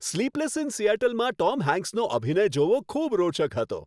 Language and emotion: Gujarati, happy